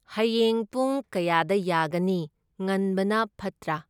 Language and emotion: Manipuri, neutral